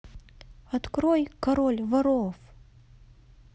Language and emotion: Russian, neutral